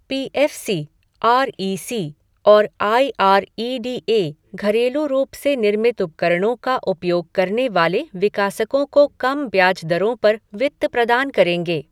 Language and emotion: Hindi, neutral